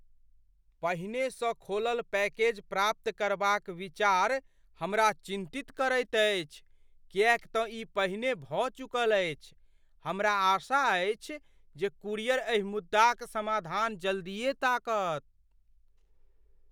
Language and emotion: Maithili, fearful